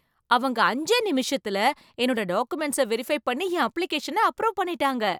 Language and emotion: Tamil, surprised